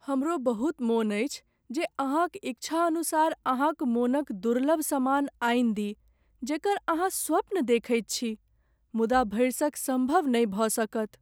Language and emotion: Maithili, sad